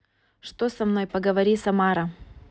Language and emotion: Russian, neutral